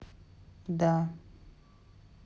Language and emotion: Russian, neutral